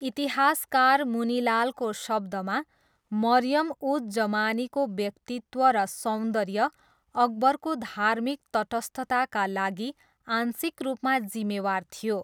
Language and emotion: Nepali, neutral